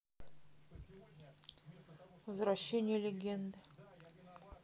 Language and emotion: Russian, neutral